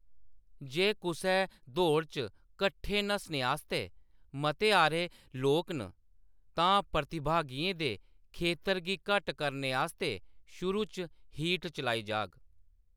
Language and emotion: Dogri, neutral